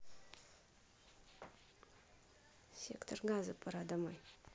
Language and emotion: Russian, neutral